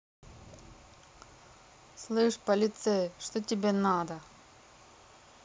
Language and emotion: Russian, angry